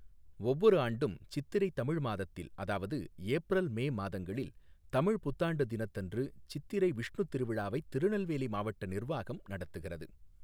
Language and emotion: Tamil, neutral